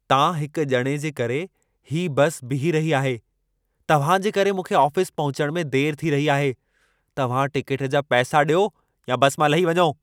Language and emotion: Sindhi, angry